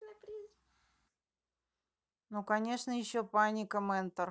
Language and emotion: Russian, neutral